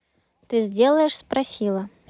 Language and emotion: Russian, neutral